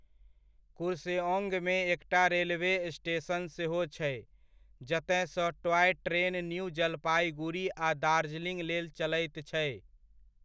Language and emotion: Maithili, neutral